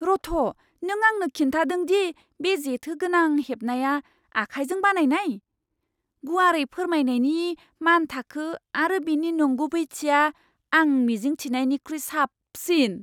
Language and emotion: Bodo, surprised